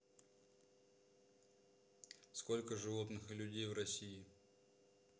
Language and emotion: Russian, neutral